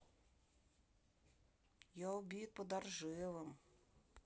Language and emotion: Russian, sad